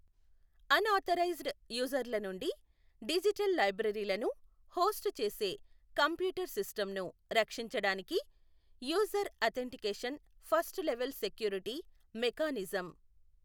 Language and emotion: Telugu, neutral